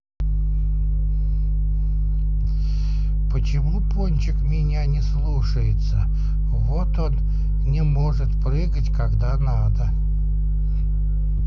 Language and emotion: Russian, sad